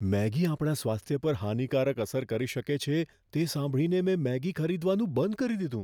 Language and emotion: Gujarati, fearful